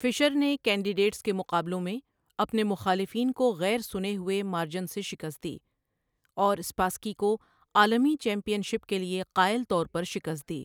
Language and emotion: Urdu, neutral